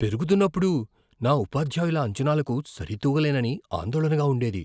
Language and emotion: Telugu, fearful